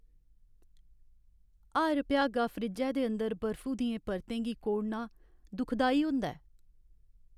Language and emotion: Dogri, sad